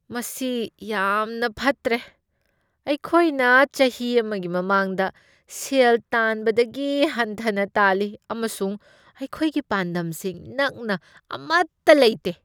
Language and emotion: Manipuri, disgusted